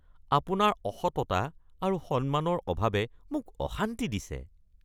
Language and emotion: Assamese, disgusted